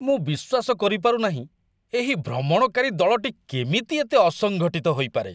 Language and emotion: Odia, disgusted